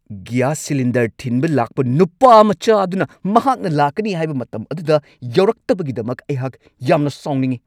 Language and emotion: Manipuri, angry